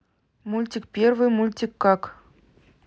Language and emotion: Russian, neutral